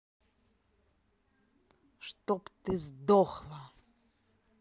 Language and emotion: Russian, angry